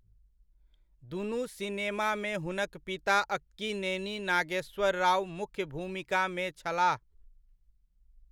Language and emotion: Maithili, neutral